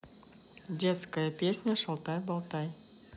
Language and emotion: Russian, neutral